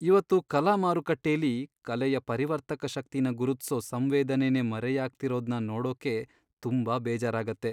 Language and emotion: Kannada, sad